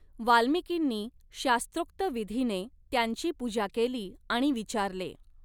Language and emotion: Marathi, neutral